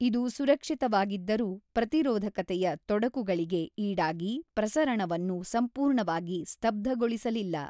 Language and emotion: Kannada, neutral